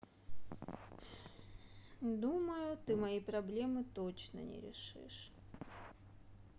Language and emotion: Russian, sad